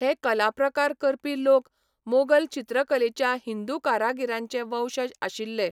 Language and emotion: Goan Konkani, neutral